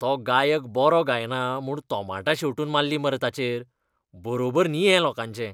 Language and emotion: Goan Konkani, disgusted